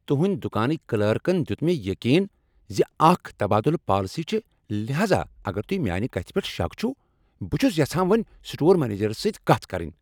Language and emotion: Kashmiri, angry